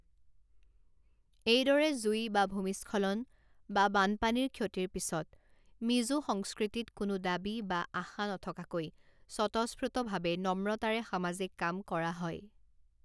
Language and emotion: Assamese, neutral